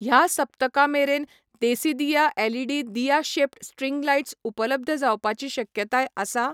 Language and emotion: Goan Konkani, neutral